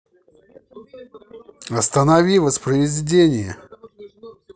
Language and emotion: Russian, angry